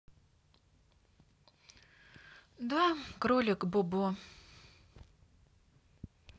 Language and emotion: Russian, sad